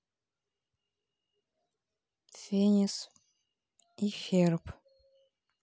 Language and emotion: Russian, neutral